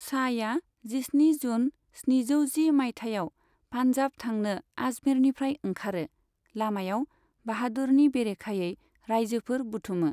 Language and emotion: Bodo, neutral